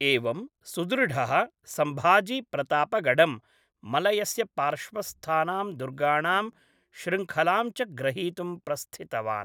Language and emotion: Sanskrit, neutral